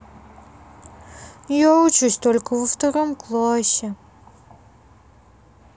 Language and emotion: Russian, sad